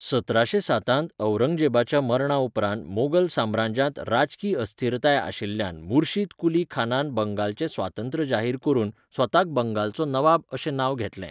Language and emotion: Goan Konkani, neutral